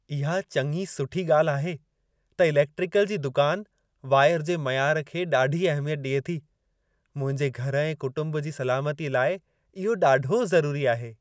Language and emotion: Sindhi, happy